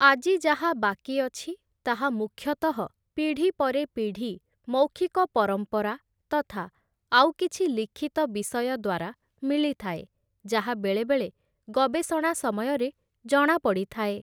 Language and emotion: Odia, neutral